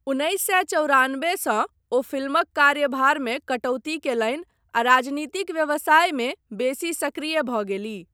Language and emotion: Maithili, neutral